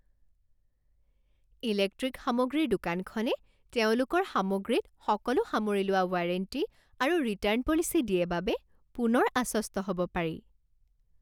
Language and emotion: Assamese, happy